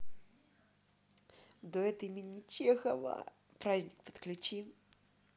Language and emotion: Russian, positive